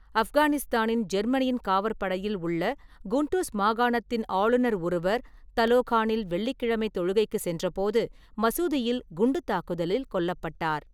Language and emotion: Tamil, neutral